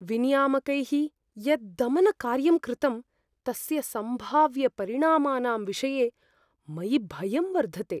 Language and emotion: Sanskrit, fearful